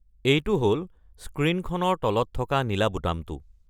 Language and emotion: Assamese, neutral